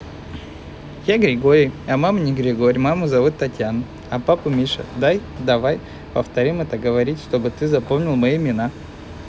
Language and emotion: Russian, neutral